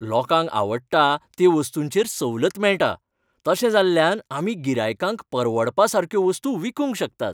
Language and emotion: Goan Konkani, happy